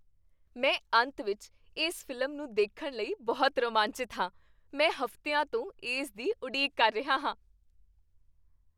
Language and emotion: Punjabi, happy